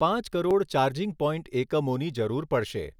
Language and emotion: Gujarati, neutral